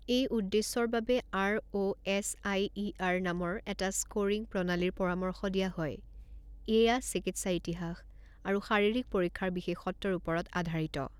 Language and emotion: Assamese, neutral